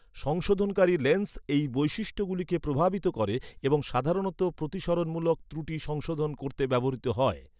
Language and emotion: Bengali, neutral